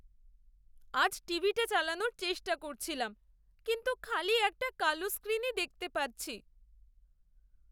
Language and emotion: Bengali, sad